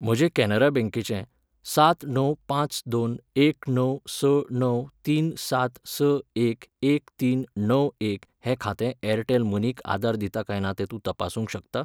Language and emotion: Goan Konkani, neutral